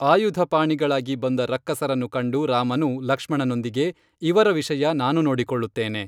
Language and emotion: Kannada, neutral